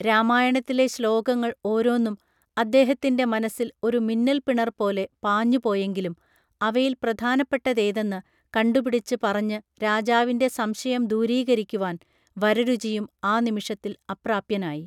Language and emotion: Malayalam, neutral